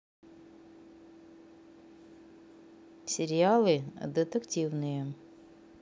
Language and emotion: Russian, neutral